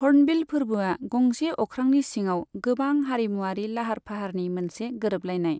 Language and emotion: Bodo, neutral